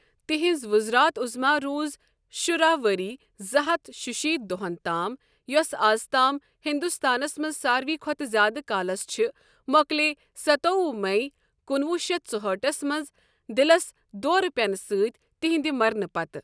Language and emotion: Kashmiri, neutral